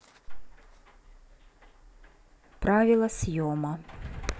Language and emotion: Russian, neutral